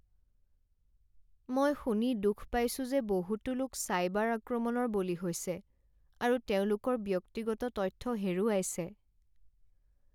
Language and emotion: Assamese, sad